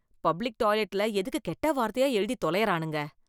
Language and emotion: Tamil, disgusted